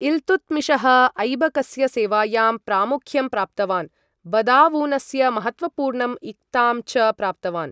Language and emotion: Sanskrit, neutral